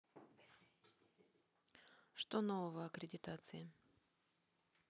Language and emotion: Russian, neutral